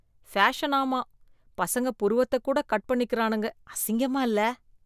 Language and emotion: Tamil, disgusted